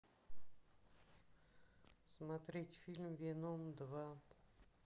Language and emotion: Russian, sad